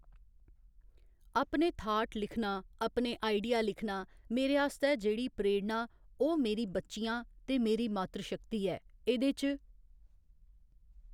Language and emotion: Dogri, neutral